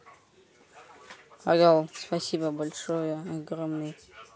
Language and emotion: Russian, neutral